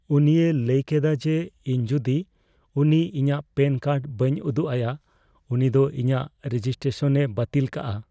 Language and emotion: Santali, fearful